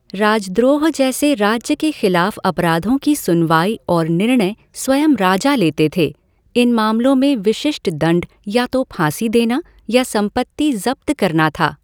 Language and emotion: Hindi, neutral